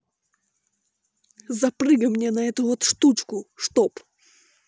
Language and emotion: Russian, angry